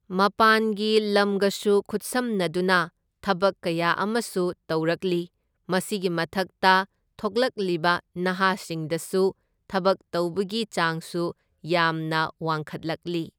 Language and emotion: Manipuri, neutral